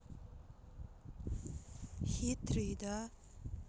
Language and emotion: Russian, sad